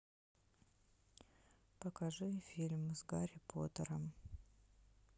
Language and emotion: Russian, neutral